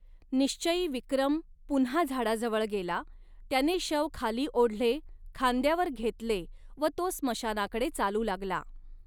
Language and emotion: Marathi, neutral